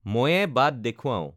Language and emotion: Assamese, neutral